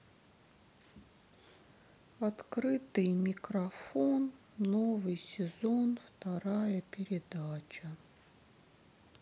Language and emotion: Russian, sad